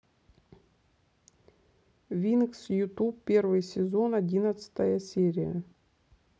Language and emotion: Russian, neutral